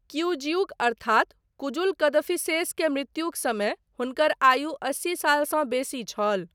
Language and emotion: Maithili, neutral